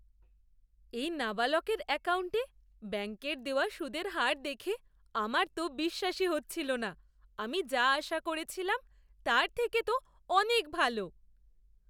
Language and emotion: Bengali, surprised